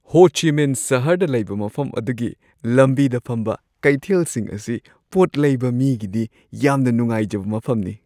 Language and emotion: Manipuri, happy